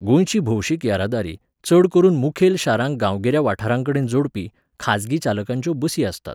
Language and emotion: Goan Konkani, neutral